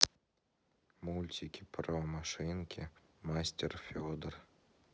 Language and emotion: Russian, sad